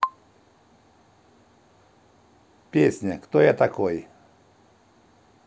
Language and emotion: Russian, neutral